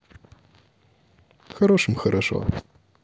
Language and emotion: Russian, neutral